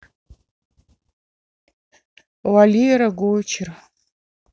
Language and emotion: Russian, neutral